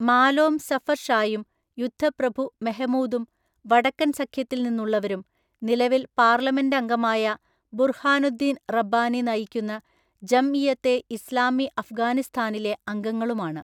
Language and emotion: Malayalam, neutral